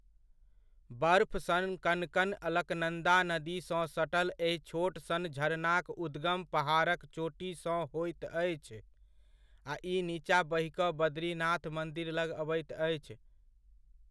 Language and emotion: Maithili, neutral